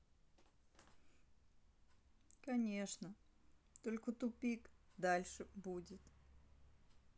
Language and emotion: Russian, sad